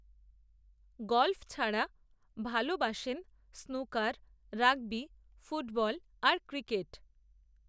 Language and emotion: Bengali, neutral